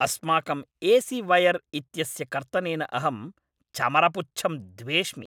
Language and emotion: Sanskrit, angry